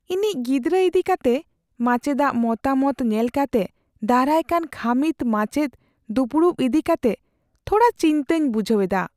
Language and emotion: Santali, fearful